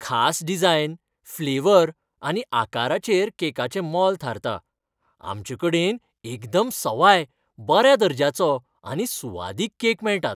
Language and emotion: Goan Konkani, happy